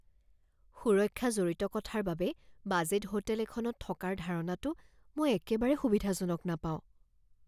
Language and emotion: Assamese, fearful